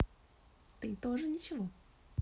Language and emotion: Russian, neutral